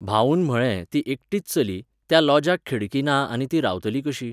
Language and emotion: Goan Konkani, neutral